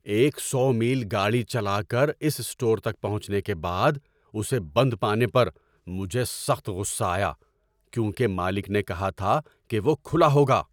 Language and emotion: Urdu, angry